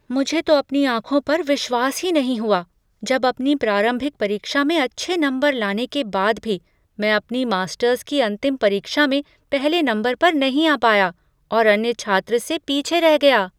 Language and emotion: Hindi, surprised